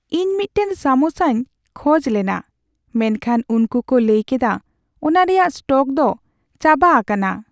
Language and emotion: Santali, sad